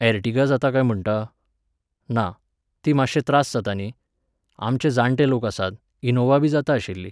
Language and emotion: Goan Konkani, neutral